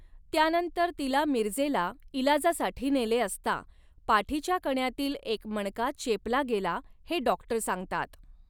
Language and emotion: Marathi, neutral